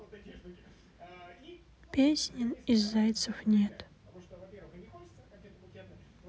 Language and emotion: Russian, sad